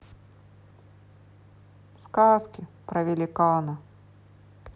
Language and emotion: Russian, sad